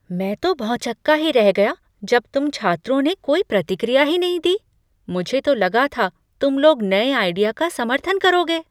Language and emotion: Hindi, surprised